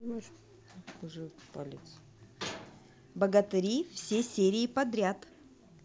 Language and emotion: Russian, positive